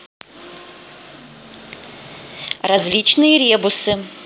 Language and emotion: Russian, neutral